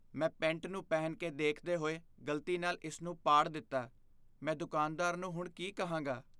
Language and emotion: Punjabi, fearful